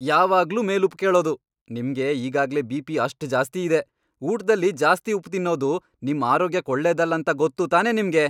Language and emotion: Kannada, angry